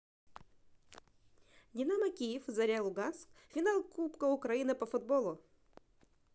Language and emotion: Russian, positive